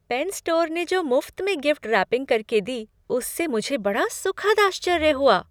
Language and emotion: Hindi, surprised